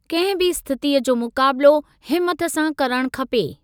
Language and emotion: Sindhi, neutral